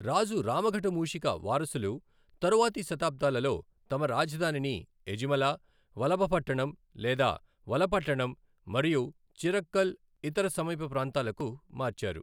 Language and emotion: Telugu, neutral